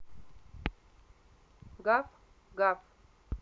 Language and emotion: Russian, positive